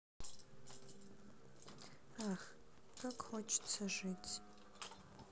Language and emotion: Russian, sad